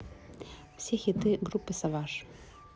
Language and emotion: Russian, neutral